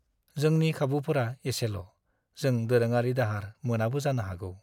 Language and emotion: Bodo, sad